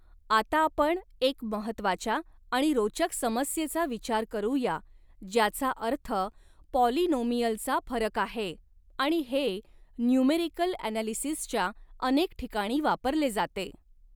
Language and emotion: Marathi, neutral